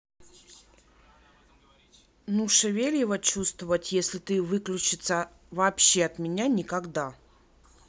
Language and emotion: Russian, neutral